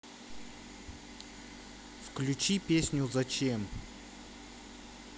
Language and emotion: Russian, neutral